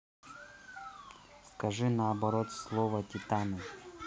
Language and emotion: Russian, neutral